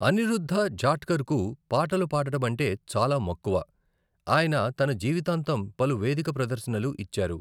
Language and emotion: Telugu, neutral